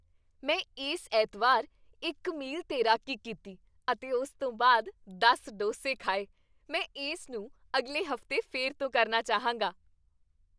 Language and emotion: Punjabi, happy